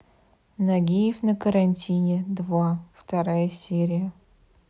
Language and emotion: Russian, neutral